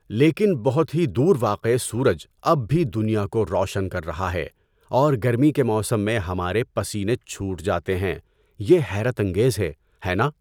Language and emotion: Urdu, neutral